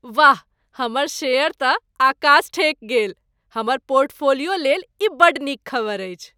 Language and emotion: Maithili, happy